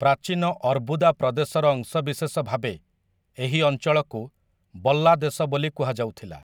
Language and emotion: Odia, neutral